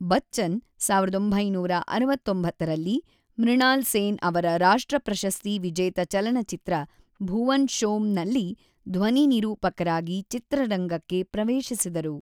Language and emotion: Kannada, neutral